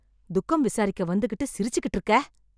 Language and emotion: Tamil, angry